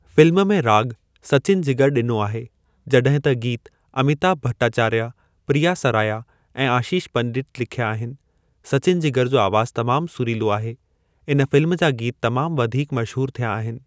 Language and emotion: Sindhi, neutral